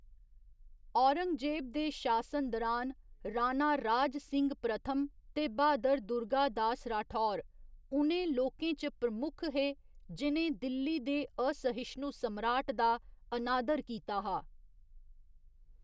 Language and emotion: Dogri, neutral